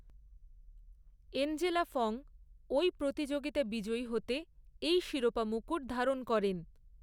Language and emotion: Bengali, neutral